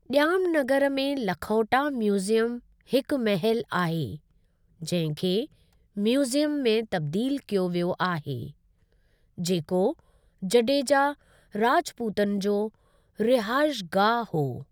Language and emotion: Sindhi, neutral